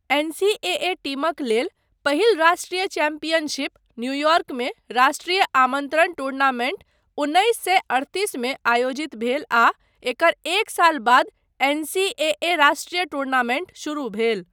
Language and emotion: Maithili, neutral